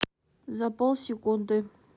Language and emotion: Russian, neutral